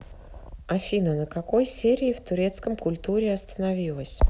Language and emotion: Russian, neutral